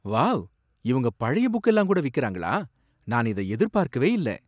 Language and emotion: Tamil, surprised